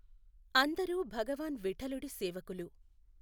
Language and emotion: Telugu, neutral